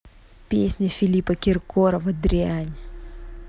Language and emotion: Russian, angry